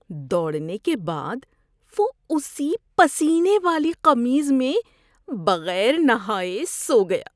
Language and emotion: Urdu, disgusted